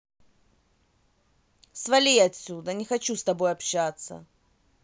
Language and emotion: Russian, angry